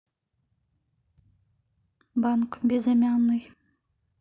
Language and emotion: Russian, neutral